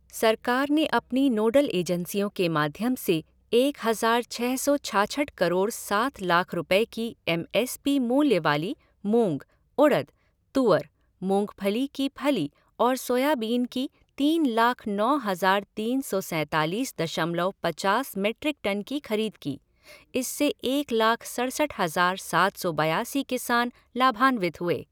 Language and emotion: Hindi, neutral